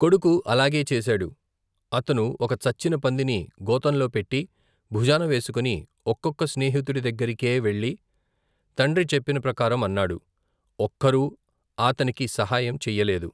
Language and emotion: Telugu, neutral